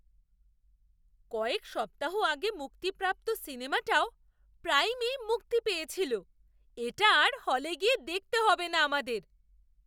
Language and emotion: Bengali, surprised